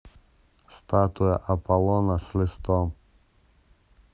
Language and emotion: Russian, neutral